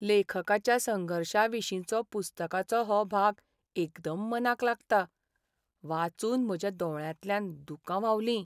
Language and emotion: Goan Konkani, sad